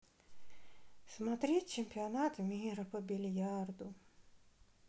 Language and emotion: Russian, sad